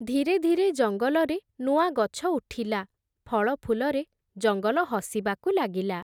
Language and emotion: Odia, neutral